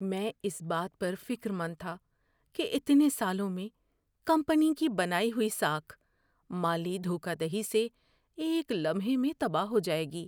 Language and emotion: Urdu, fearful